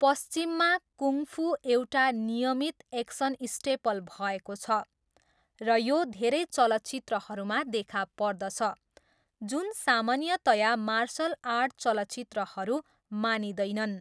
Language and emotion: Nepali, neutral